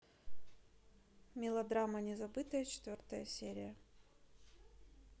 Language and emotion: Russian, neutral